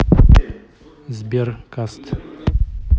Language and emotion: Russian, neutral